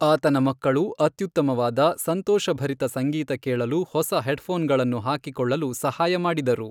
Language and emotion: Kannada, neutral